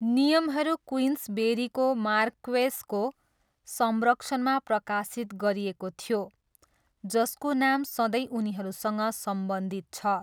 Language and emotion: Nepali, neutral